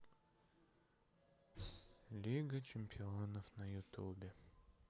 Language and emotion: Russian, sad